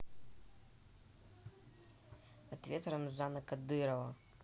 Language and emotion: Russian, angry